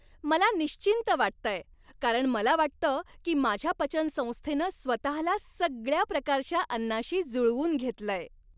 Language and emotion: Marathi, happy